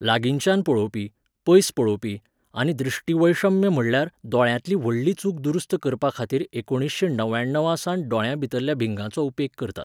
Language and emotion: Goan Konkani, neutral